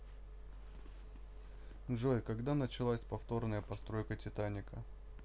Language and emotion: Russian, neutral